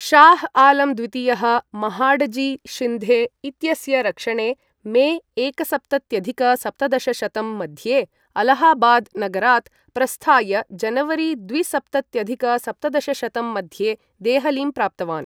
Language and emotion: Sanskrit, neutral